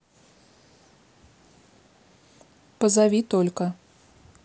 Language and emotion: Russian, neutral